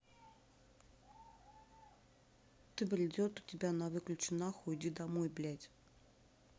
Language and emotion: Russian, neutral